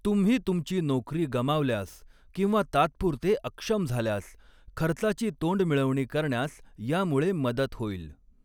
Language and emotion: Marathi, neutral